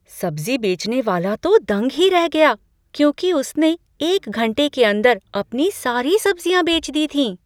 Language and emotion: Hindi, surprised